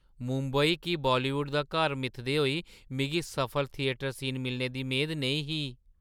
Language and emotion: Dogri, surprised